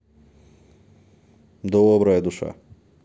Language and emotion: Russian, positive